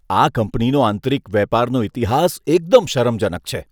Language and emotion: Gujarati, disgusted